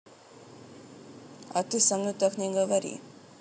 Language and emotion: Russian, neutral